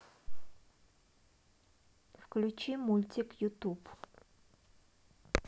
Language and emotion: Russian, neutral